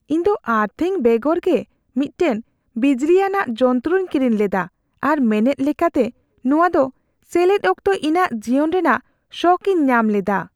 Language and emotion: Santali, fearful